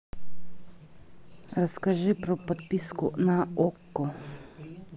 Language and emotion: Russian, neutral